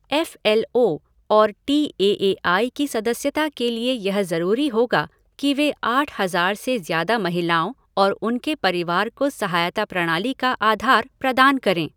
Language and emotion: Hindi, neutral